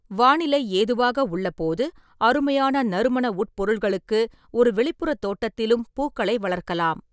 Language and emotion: Tamil, neutral